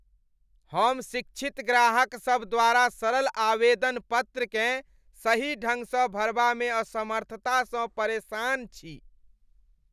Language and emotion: Maithili, disgusted